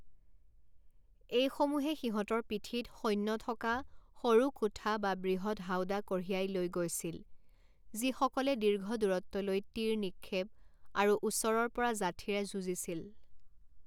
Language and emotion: Assamese, neutral